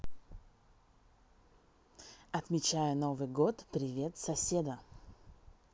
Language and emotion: Russian, positive